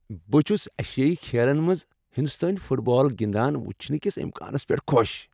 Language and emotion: Kashmiri, happy